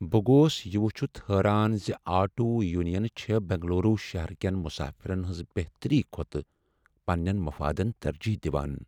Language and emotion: Kashmiri, sad